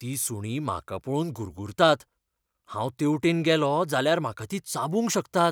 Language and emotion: Goan Konkani, fearful